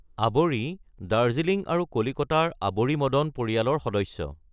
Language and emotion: Assamese, neutral